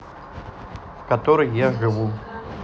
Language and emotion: Russian, neutral